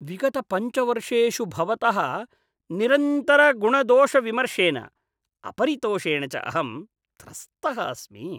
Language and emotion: Sanskrit, disgusted